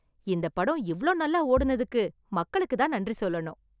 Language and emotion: Tamil, happy